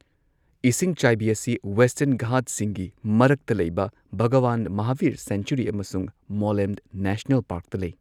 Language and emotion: Manipuri, neutral